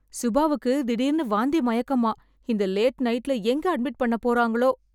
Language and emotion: Tamil, fearful